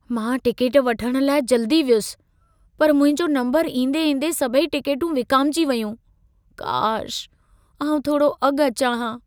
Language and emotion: Sindhi, sad